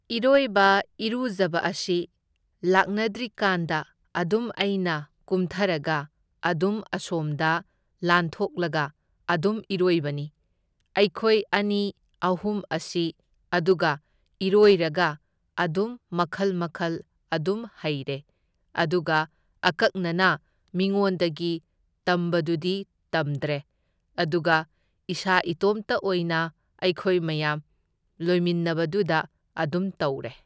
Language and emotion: Manipuri, neutral